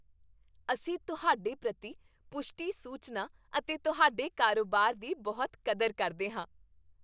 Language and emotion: Punjabi, happy